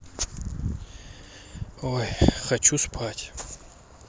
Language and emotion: Russian, neutral